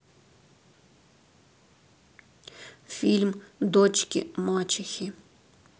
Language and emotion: Russian, sad